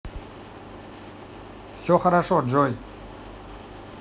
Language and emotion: Russian, neutral